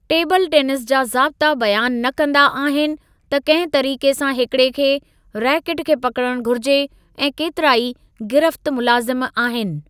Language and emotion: Sindhi, neutral